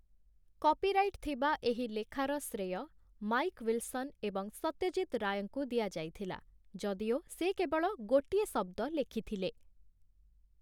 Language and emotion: Odia, neutral